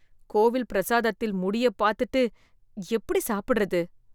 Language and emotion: Tamil, disgusted